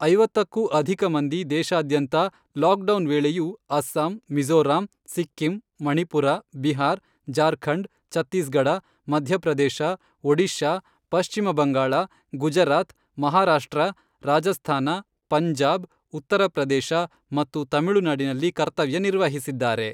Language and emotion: Kannada, neutral